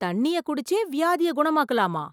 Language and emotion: Tamil, surprised